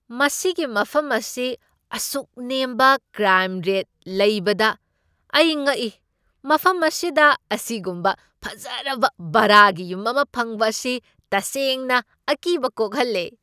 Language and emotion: Manipuri, surprised